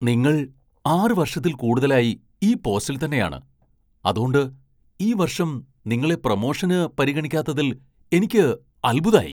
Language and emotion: Malayalam, surprised